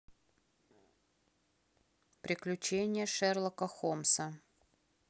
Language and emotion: Russian, neutral